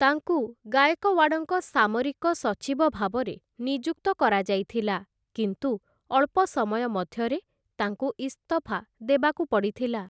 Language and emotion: Odia, neutral